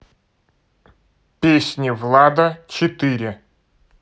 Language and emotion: Russian, neutral